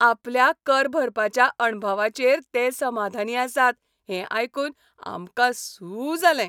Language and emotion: Goan Konkani, happy